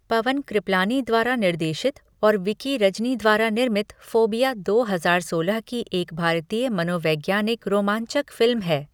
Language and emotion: Hindi, neutral